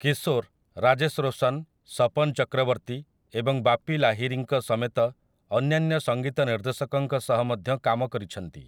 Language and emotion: Odia, neutral